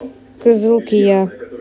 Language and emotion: Russian, neutral